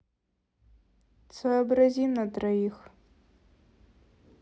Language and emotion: Russian, neutral